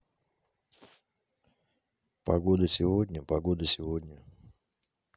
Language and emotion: Russian, neutral